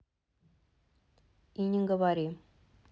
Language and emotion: Russian, neutral